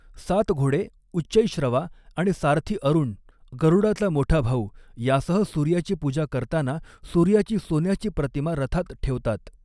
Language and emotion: Marathi, neutral